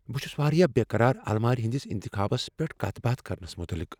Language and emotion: Kashmiri, fearful